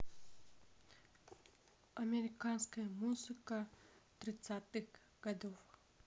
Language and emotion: Russian, neutral